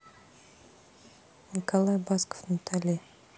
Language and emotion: Russian, neutral